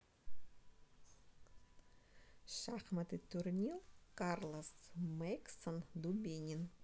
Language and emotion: Russian, neutral